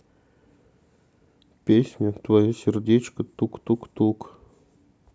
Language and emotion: Russian, sad